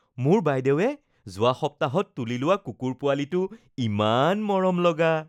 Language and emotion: Assamese, happy